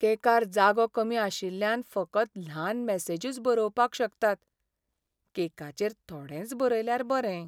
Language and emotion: Goan Konkani, sad